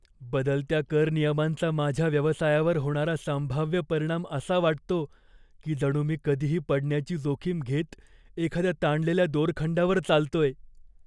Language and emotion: Marathi, fearful